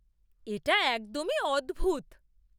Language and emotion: Bengali, surprised